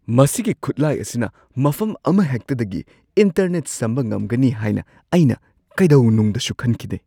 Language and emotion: Manipuri, surprised